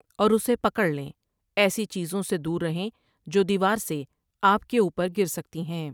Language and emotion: Urdu, neutral